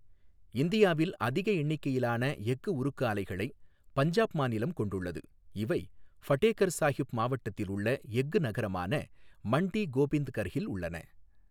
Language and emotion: Tamil, neutral